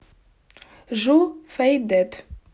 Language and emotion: Russian, neutral